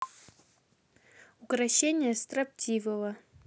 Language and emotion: Russian, neutral